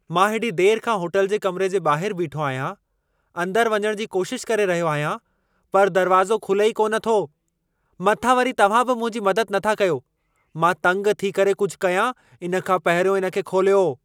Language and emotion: Sindhi, angry